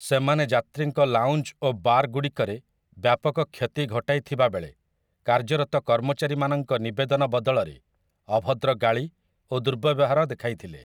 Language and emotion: Odia, neutral